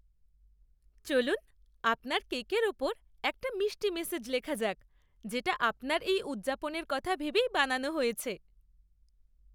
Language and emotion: Bengali, happy